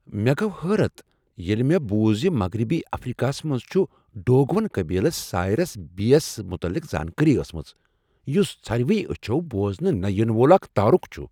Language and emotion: Kashmiri, surprised